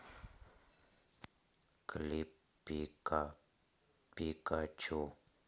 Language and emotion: Russian, sad